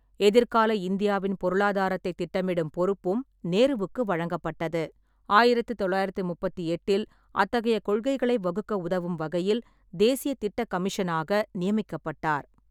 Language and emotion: Tamil, neutral